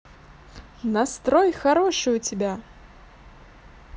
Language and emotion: Russian, positive